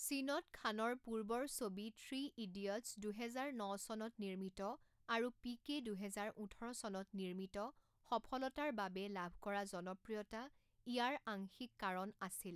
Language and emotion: Assamese, neutral